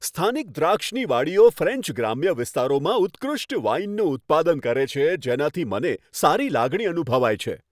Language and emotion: Gujarati, happy